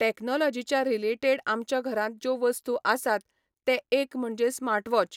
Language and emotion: Goan Konkani, neutral